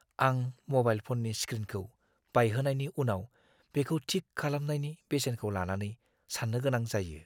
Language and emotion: Bodo, fearful